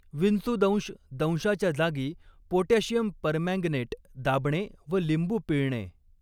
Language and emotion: Marathi, neutral